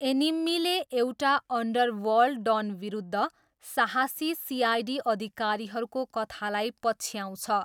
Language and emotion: Nepali, neutral